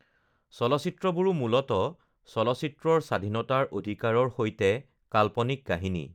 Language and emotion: Assamese, neutral